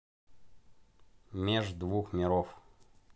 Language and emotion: Russian, neutral